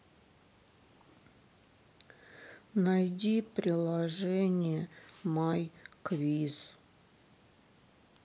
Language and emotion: Russian, sad